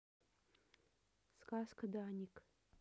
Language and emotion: Russian, neutral